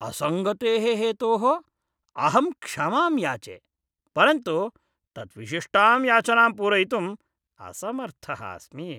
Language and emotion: Sanskrit, disgusted